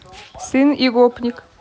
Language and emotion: Russian, neutral